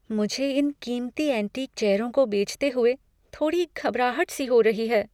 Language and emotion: Hindi, fearful